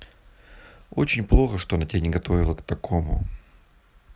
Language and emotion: Russian, sad